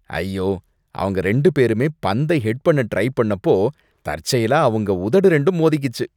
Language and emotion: Tamil, disgusted